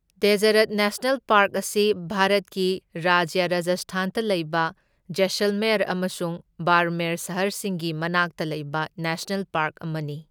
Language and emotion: Manipuri, neutral